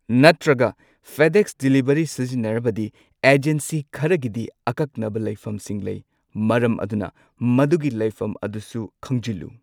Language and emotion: Manipuri, neutral